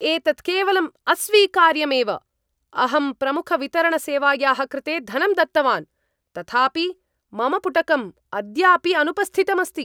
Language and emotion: Sanskrit, angry